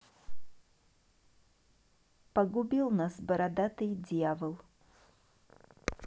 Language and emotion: Russian, neutral